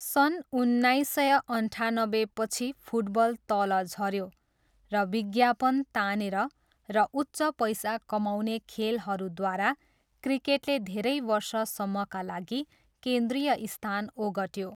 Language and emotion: Nepali, neutral